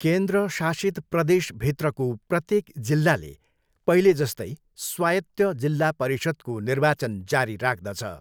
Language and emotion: Nepali, neutral